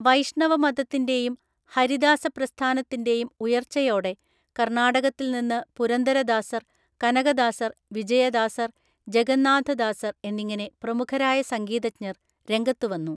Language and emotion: Malayalam, neutral